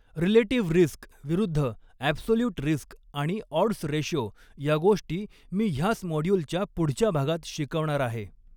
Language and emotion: Marathi, neutral